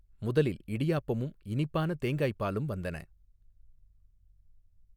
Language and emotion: Tamil, neutral